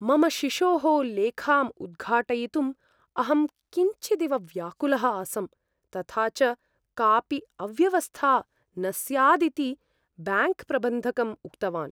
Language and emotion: Sanskrit, fearful